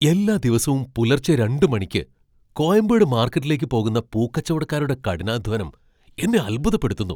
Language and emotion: Malayalam, surprised